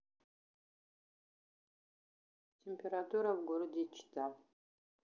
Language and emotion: Russian, neutral